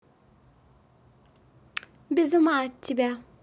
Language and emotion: Russian, positive